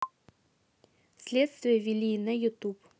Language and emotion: Russian, neutral